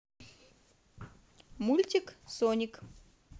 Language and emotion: Russian, positive